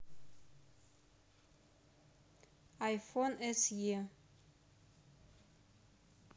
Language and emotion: Russian, neutral